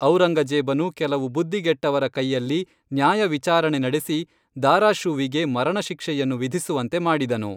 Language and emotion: Kannada, neutral